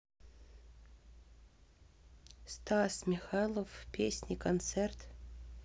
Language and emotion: Russian, neutral